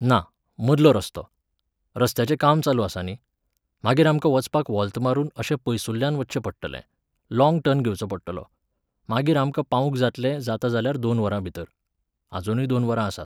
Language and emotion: Goan Konkani, neutral